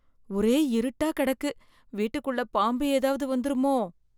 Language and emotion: Tamil, fearful